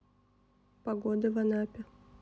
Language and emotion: Russian, neutral